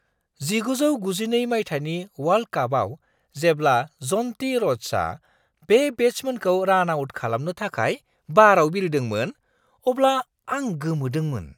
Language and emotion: Bodo, surprised